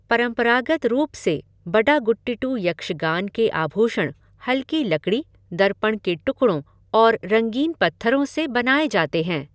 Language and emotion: Hindi, neutral